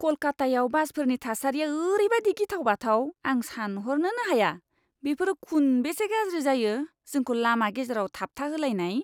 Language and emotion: Bodo, disgusted